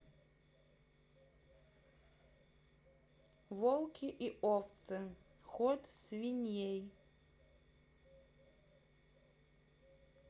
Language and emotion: Russian, neutral